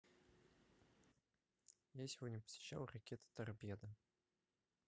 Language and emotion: Russian, neutral